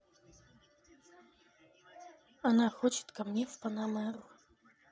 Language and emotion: Russian, neutral